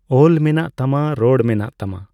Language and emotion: Santali, neutral